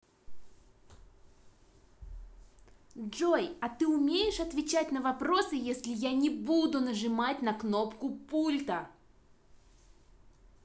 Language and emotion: Russian, angry